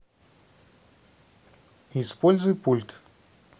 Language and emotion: Russian, neutral